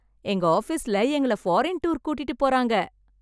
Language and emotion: Tamil, happy